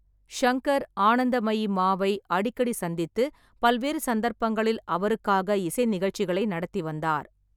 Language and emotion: Tamil, neutral